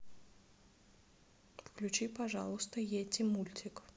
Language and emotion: Russian, neutral